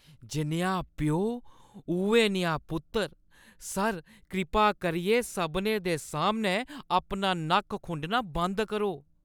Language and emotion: Dogri, disgusted